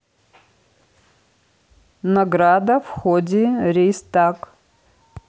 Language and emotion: Russian, neutral